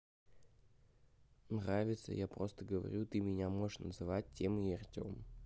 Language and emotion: Russian, neutral